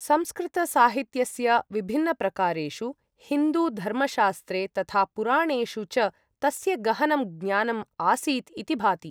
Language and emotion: Sanskrit, neutral